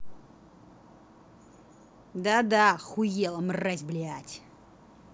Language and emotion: Russian, angry